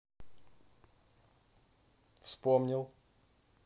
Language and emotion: Russian, neutral